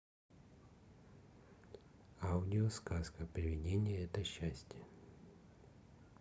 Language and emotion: Russian, neutral